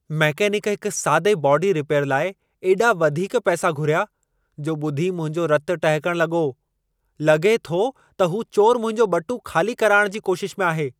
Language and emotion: Sindhi, angry